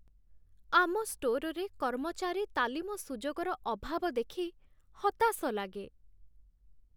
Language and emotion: Odia, sad